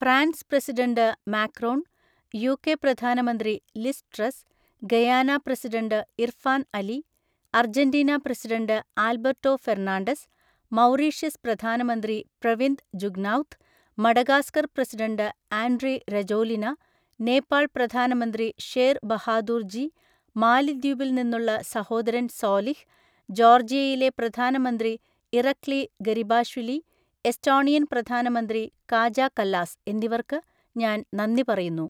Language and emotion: Malayalam, neutral